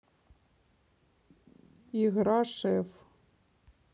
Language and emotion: Russian, neutral